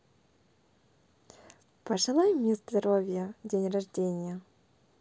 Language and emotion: Russian, neutral